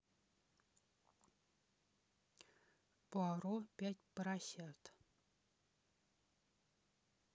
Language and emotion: Russian, neutral